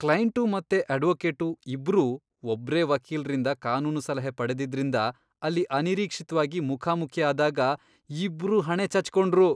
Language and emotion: Kannada, disgusted